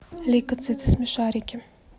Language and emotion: Russian, neutral